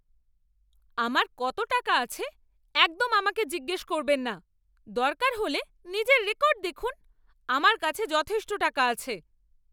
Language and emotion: Bengali, angry